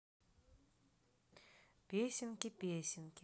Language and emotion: Russian, neutral